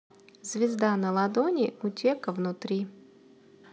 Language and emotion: Russian, neutral